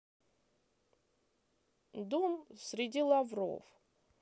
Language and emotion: Russian, neutral